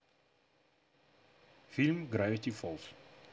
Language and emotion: Russian, neutral